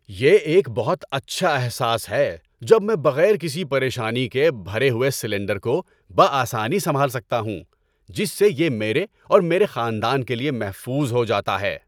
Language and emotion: Urdu, happy